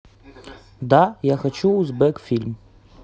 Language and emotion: Russian, neutral